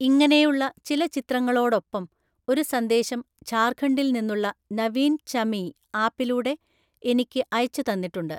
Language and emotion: Malayalam, neutral